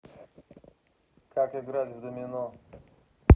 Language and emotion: Russian, neutral